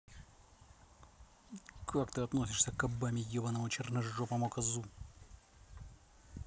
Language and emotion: Russian, angry